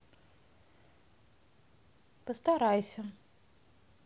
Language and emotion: Russian, neutral